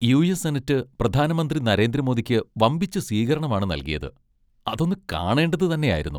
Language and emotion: Malayalam, happy